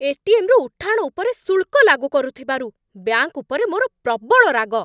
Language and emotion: Odia, angry